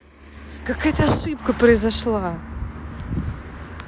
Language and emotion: Russian, angry